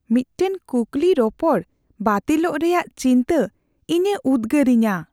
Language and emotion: Santali, fearful